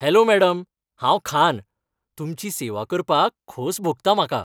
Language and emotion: Goan Konkani, happy